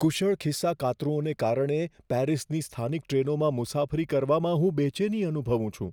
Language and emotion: Gujarati, fearful